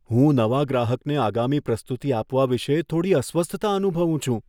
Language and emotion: Gujarati, fearful